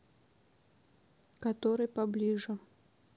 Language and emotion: Russian, neutral